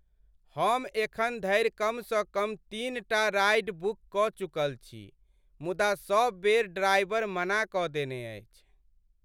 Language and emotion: Maithili, sad